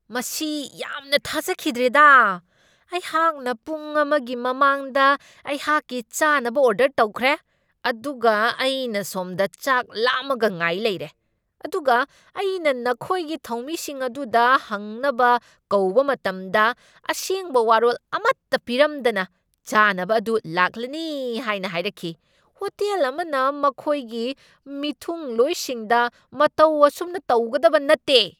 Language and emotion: Manipuri, angry